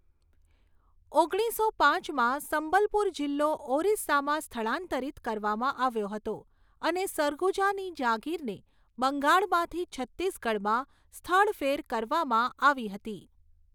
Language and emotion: Gujarati, neutral